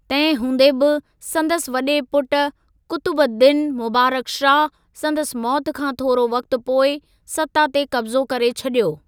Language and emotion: Sindhi, neutral